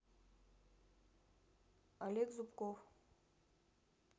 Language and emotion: Russian, neutral